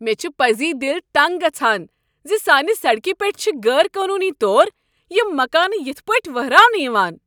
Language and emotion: Kashmiri, angry